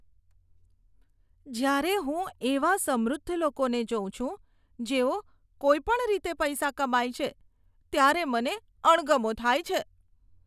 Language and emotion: Gujarati, disgusted